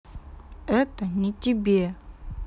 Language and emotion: Russian, sad